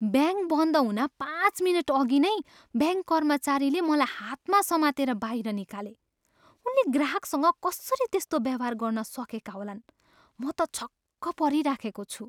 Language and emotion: Nepali, surprised